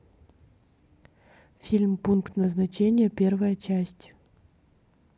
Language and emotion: Russian, neutral